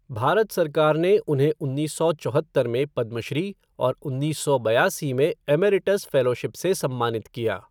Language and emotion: Hindi, neutral